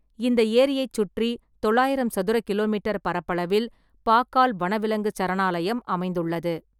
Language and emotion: Tamil, neutral